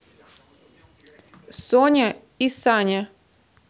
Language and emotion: Russian, neutral